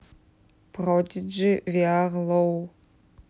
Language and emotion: Russian, neutral